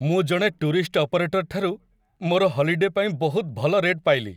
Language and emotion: Odia, happy